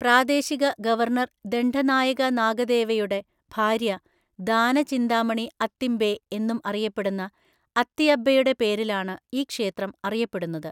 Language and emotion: Malayalam, neutral